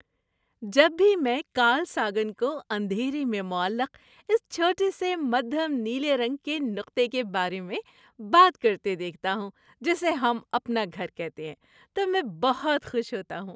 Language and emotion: Urdu, happy